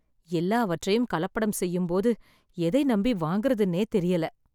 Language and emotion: Tamil, sad